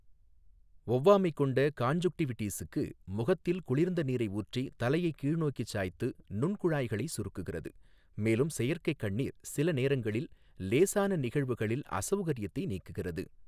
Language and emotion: Tamil, neutral